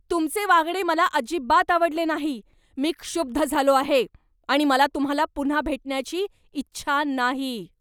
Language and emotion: Marathi, angry